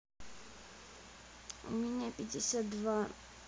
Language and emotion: Russian, sad